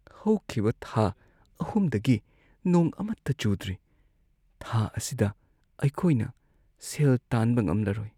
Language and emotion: Manipuri, sad